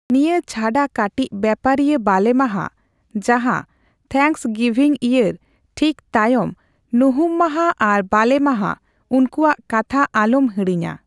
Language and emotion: Santali, neutral